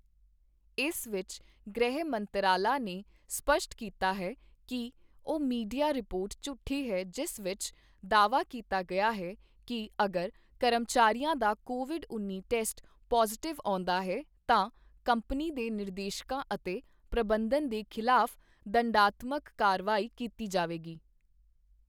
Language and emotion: Punjabi, neutral